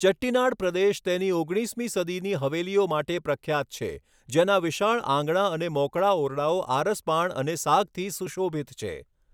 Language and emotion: Gujarati, neutral